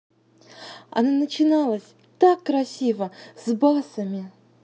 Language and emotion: Russian, positive